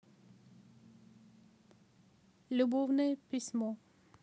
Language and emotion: Russian, neutral